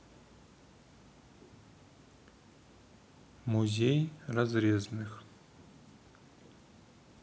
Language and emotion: Russian, neutral